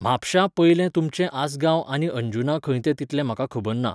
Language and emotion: Goan Konkani, neutral